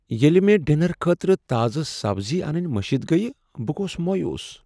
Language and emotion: Kashmiri, sad